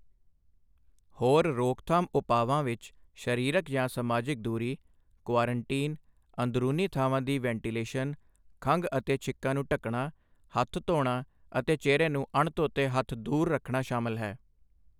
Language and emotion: Punjabi, neutral